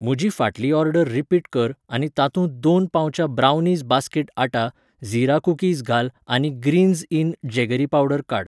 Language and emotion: Goan Konkani, neutral